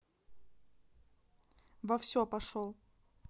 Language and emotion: Russian, neutral